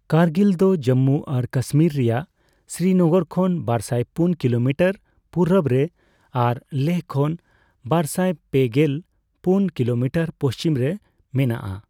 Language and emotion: Santali, neutral